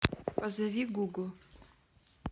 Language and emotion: Russian, neutral